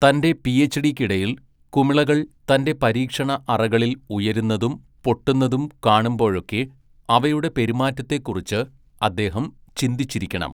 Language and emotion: Malayalam, neutral